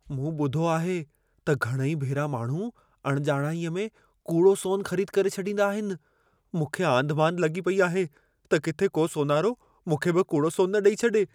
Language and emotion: Sindhi, fearful